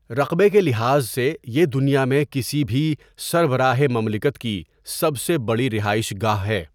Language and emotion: Urdu, neutral